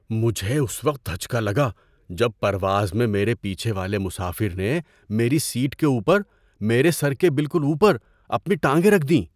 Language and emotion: Urdu, surprised